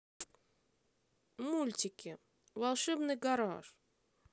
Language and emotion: Russian, positive